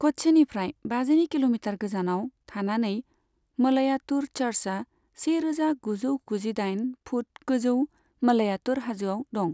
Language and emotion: Bodo, neutral